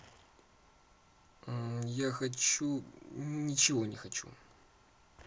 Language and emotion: Russian, neutral